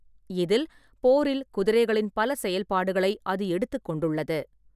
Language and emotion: Tamil, neutral